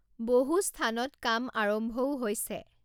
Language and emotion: Assamese, neutral